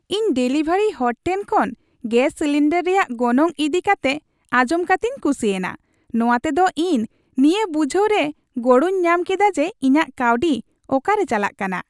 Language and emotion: Santali, happy